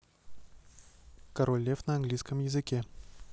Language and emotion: Russian, neutral